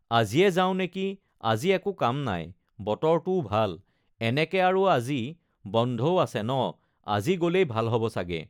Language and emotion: Assamese, neutral